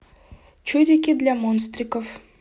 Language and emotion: Russian, neutral